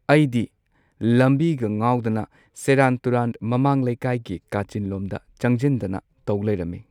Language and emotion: Manipuri, neutral